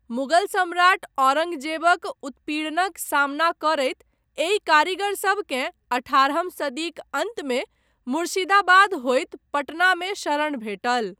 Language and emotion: Maithili, neutral